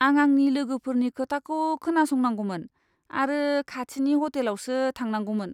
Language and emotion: Bodo, disgusted